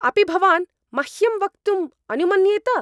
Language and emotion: Sanskrit, angry